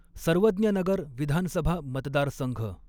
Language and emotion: Marathi, neutral